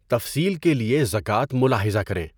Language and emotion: Urdu, neutral